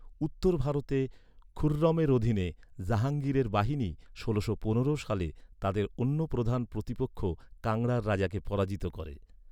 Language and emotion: Bengali, neutral